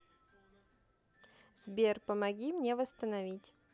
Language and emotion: Russian, neutral